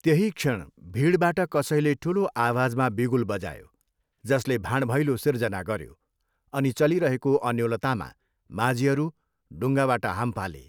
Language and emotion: Nepali, neutral